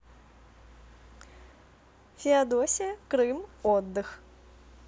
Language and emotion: Russian, positive